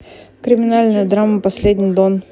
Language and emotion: Russian, neutral